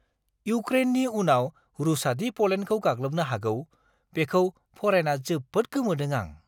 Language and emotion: Bodo, surprised